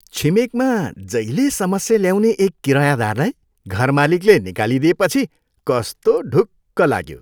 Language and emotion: Nepali, happy